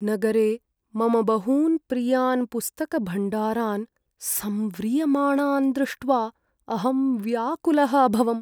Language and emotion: Sanskrit, sad